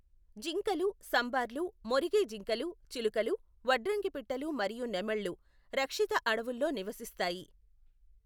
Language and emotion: Telugu, neutral